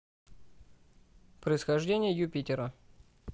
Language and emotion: Russian, neutral